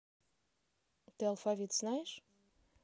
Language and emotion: Russian, neutral